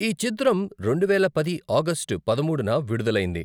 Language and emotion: Telugu, neutral